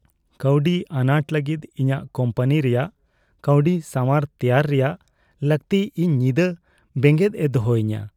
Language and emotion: Santali, fearful